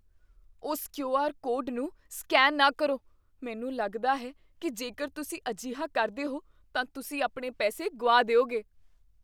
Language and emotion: Punjabi, fearful